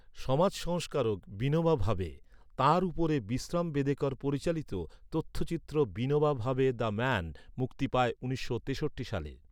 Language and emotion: Bengali, neutral